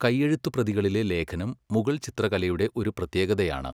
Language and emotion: Malayalam, neutral